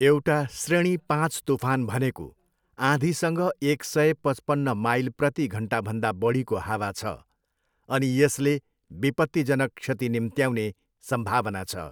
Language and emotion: Nepali, neutral